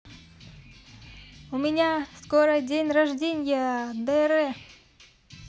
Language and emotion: Russian, positive